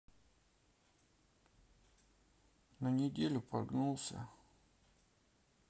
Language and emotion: Russian, sad